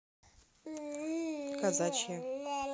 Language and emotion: Russian, neutral